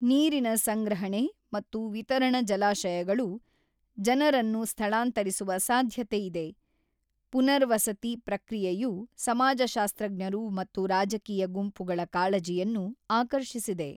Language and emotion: Kannada, neutral